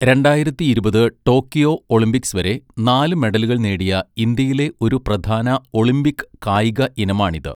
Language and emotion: Malayalam, neutral